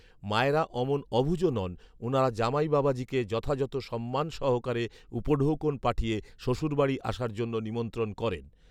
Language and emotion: Bengali, neutral